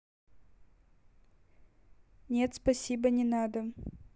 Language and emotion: Russian, neutral